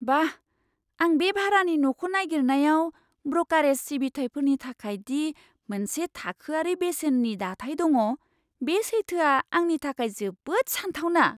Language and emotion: Bodo, surprised